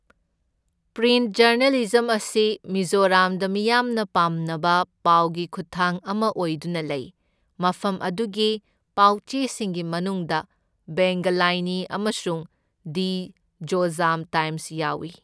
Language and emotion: Manipuri, neutral